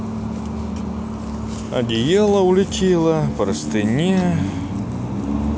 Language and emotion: Russian, neutral